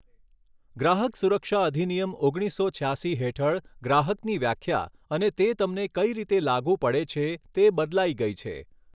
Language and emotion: Gujarati, neutral